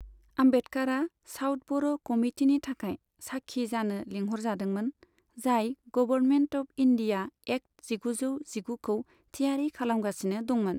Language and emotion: Bodo, neutral